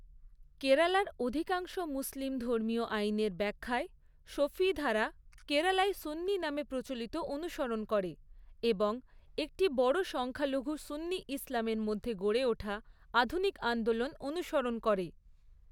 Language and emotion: Bengali, neutral